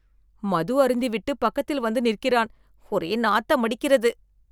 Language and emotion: Tamil, disgusted